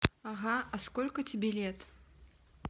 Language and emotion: Russian, neutral